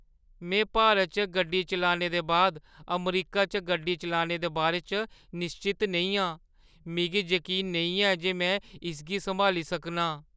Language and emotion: Dogri, fearful